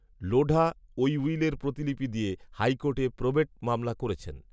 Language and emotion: Bengali, neutral